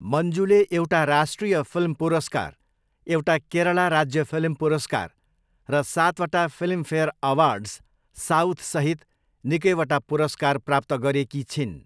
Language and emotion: Nepali, neutral